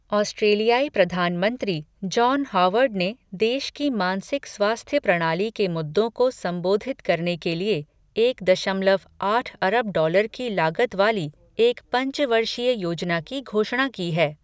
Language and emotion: Hindi, neutral